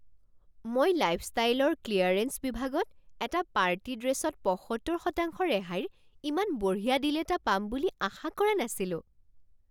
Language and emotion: Assamese, surprised